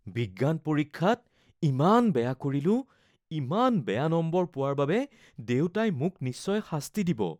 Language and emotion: Assamese, fearful